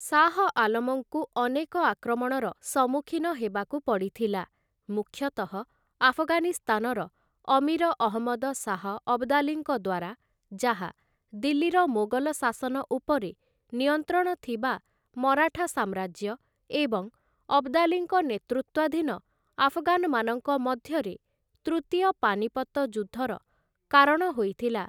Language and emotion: Odia, neutral